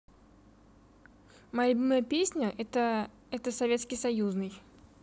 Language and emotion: Russian, neutral